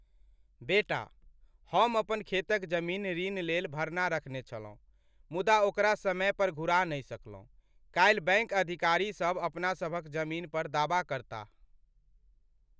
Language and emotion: Maithili, sad